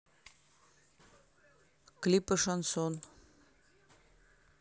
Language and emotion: Russian, neutral